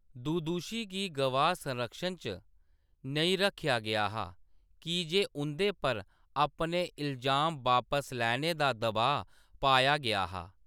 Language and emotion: Dogri, neutral